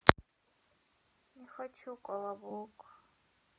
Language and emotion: Russian, sad